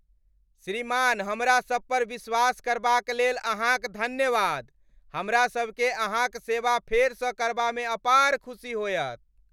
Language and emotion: Maithili, happy